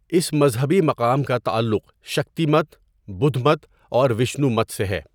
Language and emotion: Urdu, neutral